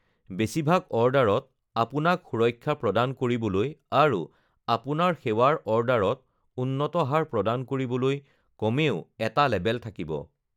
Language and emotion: Assamese, neutral